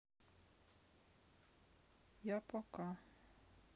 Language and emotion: Russian, sad